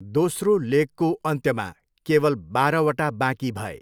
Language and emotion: Nepali, neutral